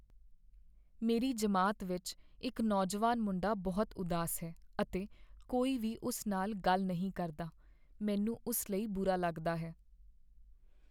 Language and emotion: Punjabi, sad